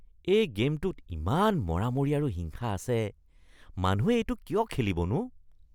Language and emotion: Assamese, disgusted